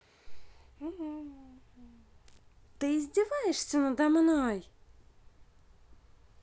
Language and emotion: Russian, neutral